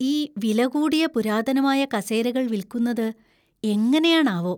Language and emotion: Malayalam, fearful